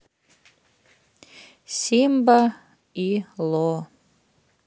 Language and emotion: Russian, neutral